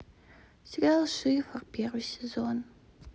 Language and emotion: Russian, sad